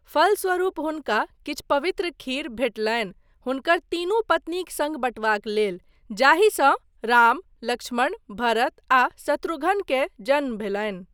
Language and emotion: Maithili, neutral